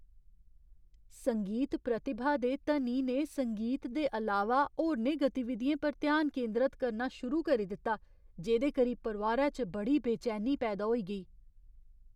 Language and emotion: Dogri, fearful